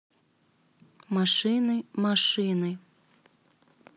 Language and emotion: Russian, neutral